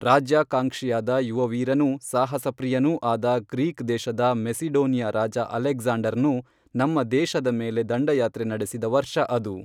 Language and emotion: Kannada, neutral